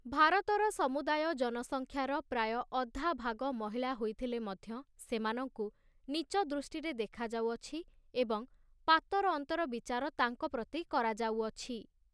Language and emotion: Odia, neutral